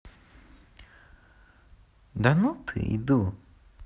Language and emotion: Russian, positive